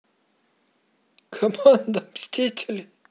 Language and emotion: Russian, positive